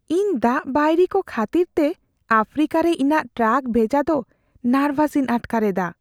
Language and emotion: Santali, fearful